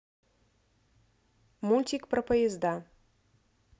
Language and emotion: Russian, neutral